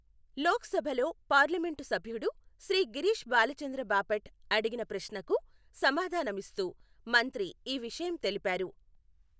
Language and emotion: Telugu, neutral